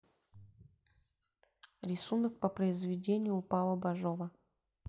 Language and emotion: Russian, neutral